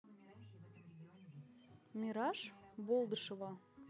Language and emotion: Russian, neutral